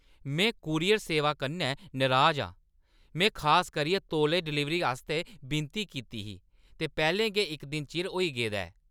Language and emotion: Dogri, angry